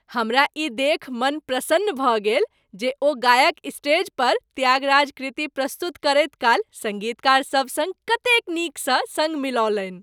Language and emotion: Maithili, happy